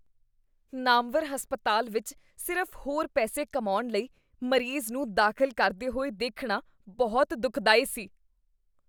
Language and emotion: Punjabi, disgusted